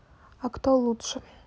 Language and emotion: Russian, neutral